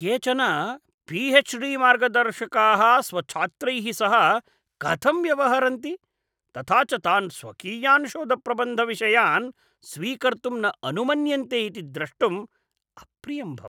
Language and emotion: Sanskrit, disgusted